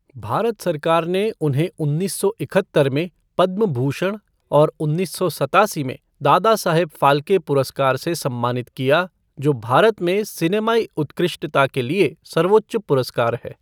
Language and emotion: Hindi, neutral